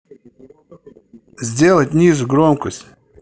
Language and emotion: Russian, angry